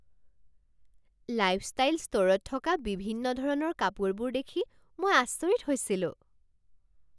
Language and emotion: Assamese, surprised